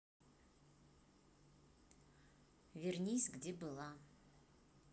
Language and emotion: Russian, neutral